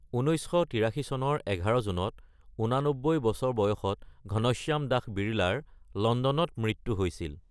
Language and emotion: Assamese, neutral